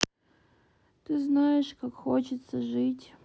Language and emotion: Russian, sad